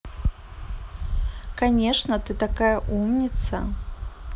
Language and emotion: Russian, positive